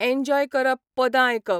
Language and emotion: Goan Konkani, neutral